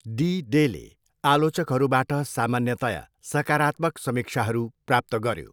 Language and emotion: Nepali, neutral